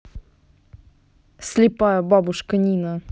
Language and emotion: Russian, angry